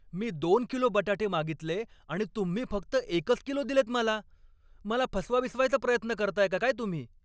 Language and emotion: Marathi, angry